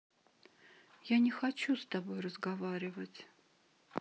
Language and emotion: Russian, sad